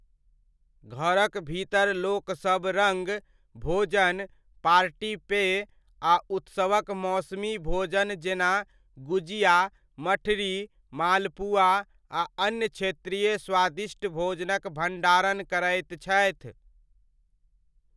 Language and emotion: Maithili, neutral